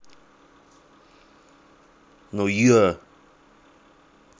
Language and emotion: Russian, angry